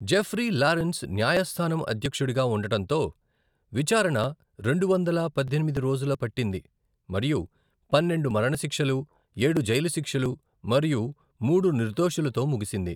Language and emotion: Telugu, neutral